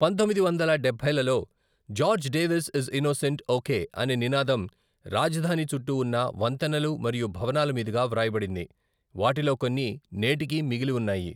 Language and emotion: Telugu, neutral